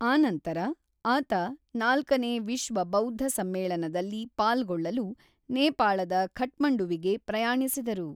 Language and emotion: Kannada, neutral